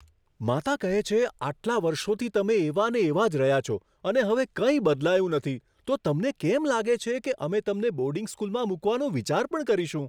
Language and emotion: Gujarati, surprised